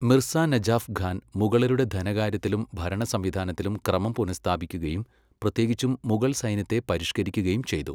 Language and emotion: Malayalam, neutral